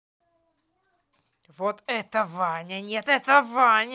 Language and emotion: Russian, angry